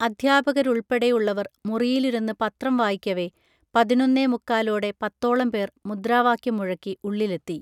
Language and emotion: Malayalam, neutral